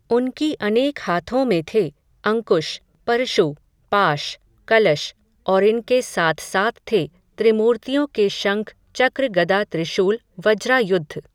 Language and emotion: Hindi, neutral